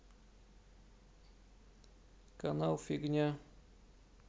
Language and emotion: Russian, sad